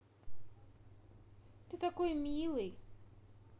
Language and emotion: Russian, positive